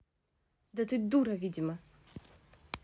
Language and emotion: Russian, angry